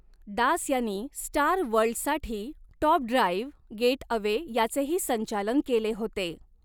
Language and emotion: Marathi, neutral